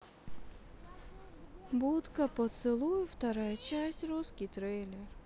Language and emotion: Russian, sad